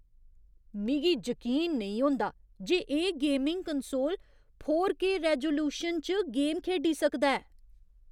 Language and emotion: Dogri, surprised